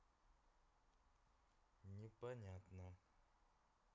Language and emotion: Russian, neutral